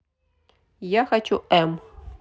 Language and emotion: Russian, neutral